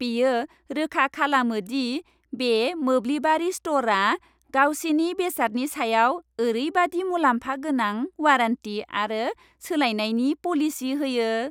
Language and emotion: Bodo, happy